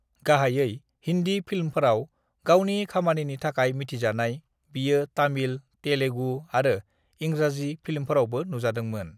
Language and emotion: Bodo, neutral